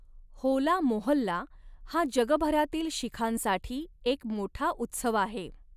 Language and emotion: Marathi, neutral